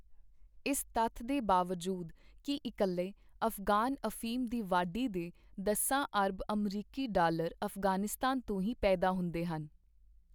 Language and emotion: Punjabi, neutral